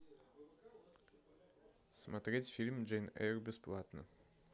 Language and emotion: Russian, neutral